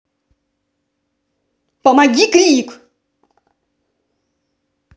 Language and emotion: Russian, angry